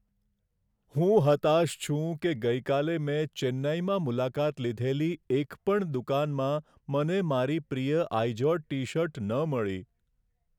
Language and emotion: Gujarati, sad